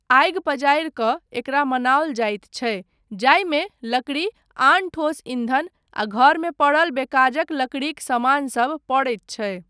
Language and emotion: Maithili, neutral